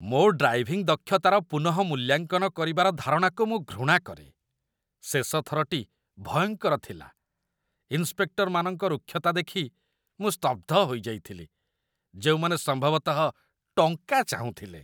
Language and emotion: Odia, disgusted